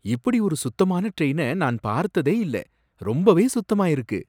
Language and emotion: Tamil, surprised